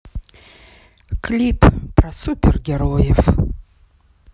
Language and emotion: Russian, sad